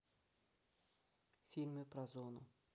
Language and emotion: Russian, neutral